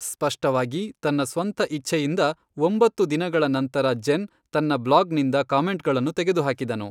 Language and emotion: Kannada, neutral